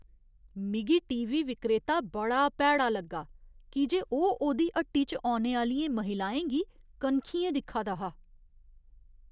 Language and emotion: Dogri, disgusted